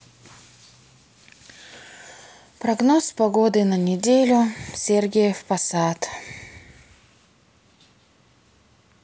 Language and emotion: Russian, sad